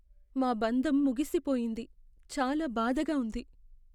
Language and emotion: Telugu, sad